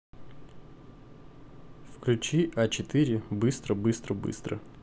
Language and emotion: Russian, neutral